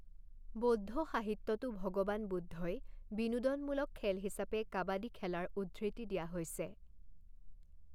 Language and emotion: Assamese, neutral